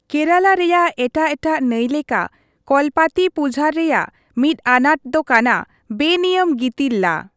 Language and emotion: Santali, neutral